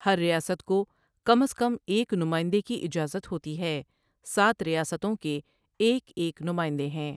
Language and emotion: Urdu, neutral